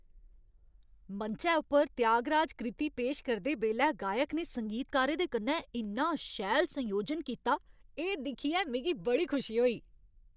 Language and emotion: Dogri, happy